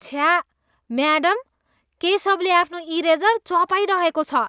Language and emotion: Nepali, disgusted